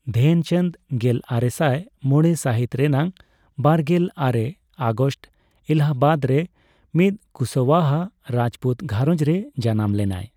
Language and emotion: Santali, neutral